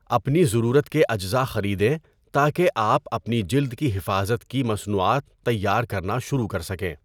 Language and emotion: Urdu, neutral